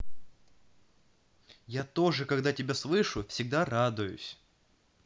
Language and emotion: Russian, positive